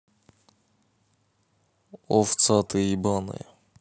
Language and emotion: Russian, neutral